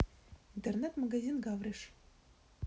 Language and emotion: Russian, neutral